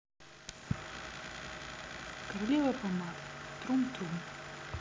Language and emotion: Russian, neutral